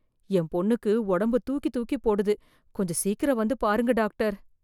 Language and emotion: Tamil, fearful